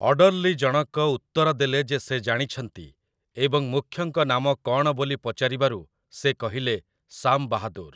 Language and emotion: Odia, neutral